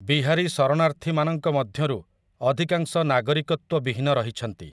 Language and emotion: Odia, neutral